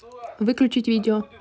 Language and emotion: Russian, neutral